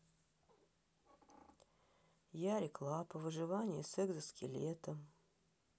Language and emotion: Russian, sad